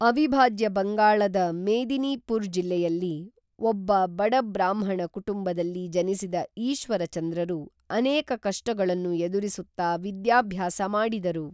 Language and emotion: Kannada, neutral